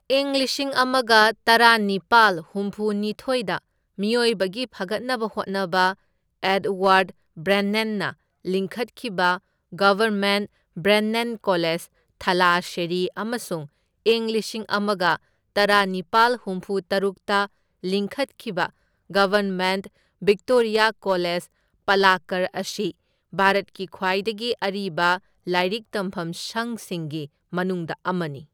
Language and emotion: Manipuri, neutral